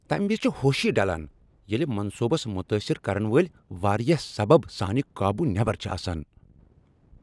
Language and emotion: Kashmiri, angry